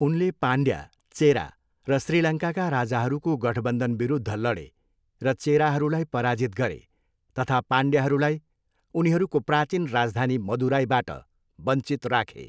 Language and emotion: Nepali, neutral